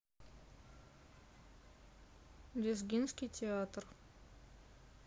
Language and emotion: Russian, sad